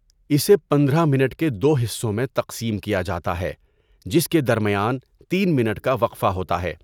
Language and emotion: Urdu, neutral